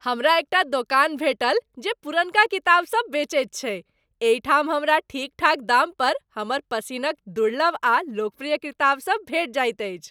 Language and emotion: Maithili, happy